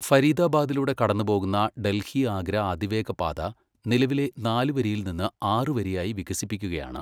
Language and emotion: Malayalam, neutral